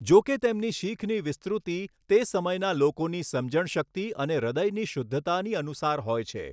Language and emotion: Gujarati, neutral